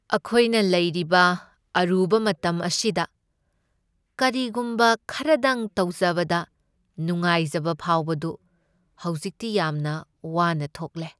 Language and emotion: Manipuri, sad